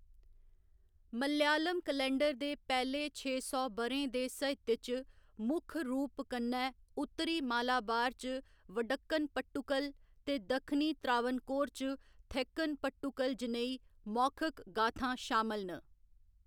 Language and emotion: Dogri, neutral